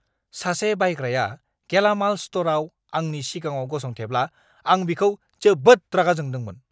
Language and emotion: Bodo, angry